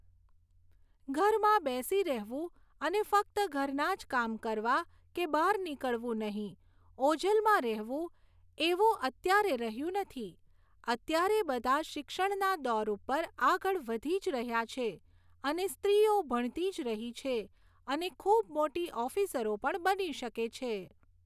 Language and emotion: Gujarati, neutral